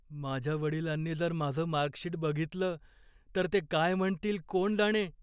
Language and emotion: Marathi, fearful